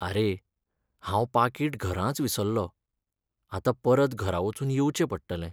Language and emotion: Goan Konkani, sad